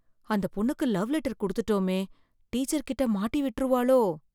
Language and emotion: Tamil, fearful